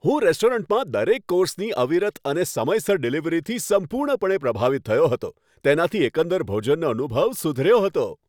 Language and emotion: Gujarati, happy